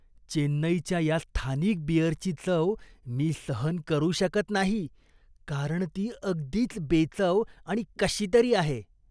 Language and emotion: Marathi, disgusted